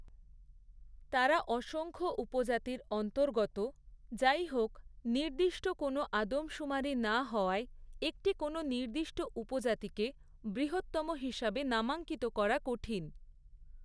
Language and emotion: Bengali, neutral